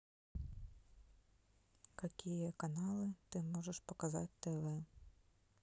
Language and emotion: Russian, neutral